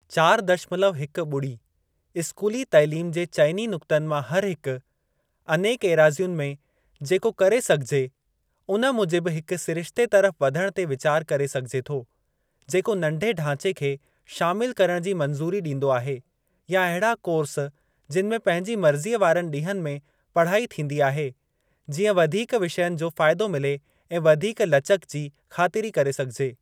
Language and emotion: Sindhi, neutral